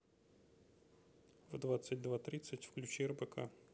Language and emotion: Russian, neutral